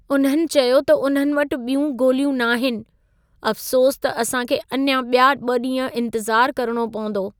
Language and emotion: Sindhi, sad